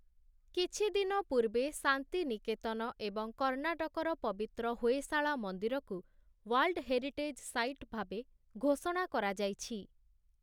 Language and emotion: Odia, neutral